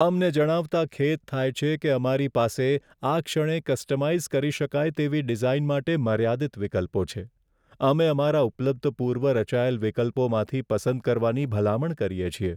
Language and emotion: Gujarati, sad